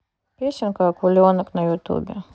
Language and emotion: Russian, neutral